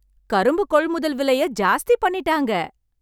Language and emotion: Tamil, happy